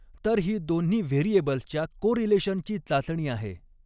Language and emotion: Marathi, neutral